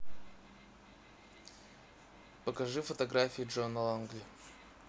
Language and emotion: Russian, neutral